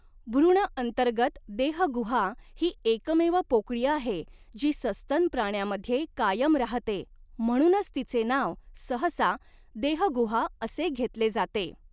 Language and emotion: Marathi, neutral